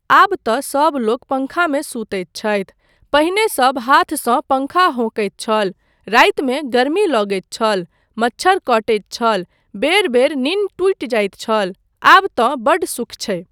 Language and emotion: Maithili, neutral